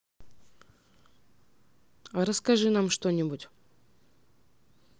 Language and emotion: Russian, neutral